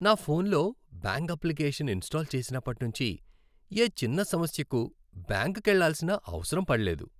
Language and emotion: Telugu, happy